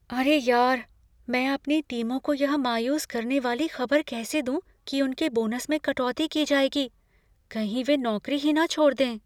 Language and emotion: Hindi, fearful